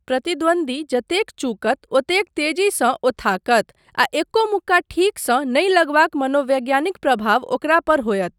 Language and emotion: Maithili, neutral